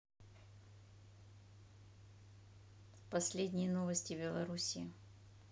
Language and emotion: Russian, neutral